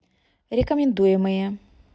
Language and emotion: Russian, neutral